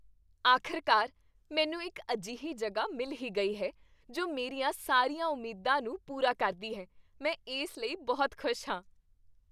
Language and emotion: Punjabi, happy